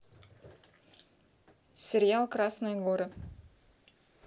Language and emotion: Russian, neutral